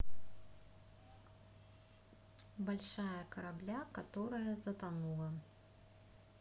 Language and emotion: Russian, neutral